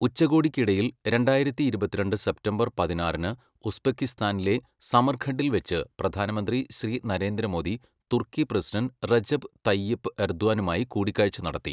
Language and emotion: Malayalam, neutral